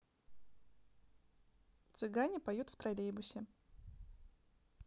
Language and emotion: Russian, neutral